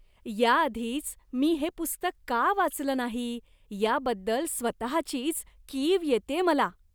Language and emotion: Marathi, disgusted